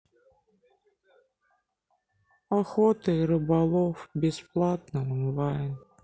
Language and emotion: Russian, sad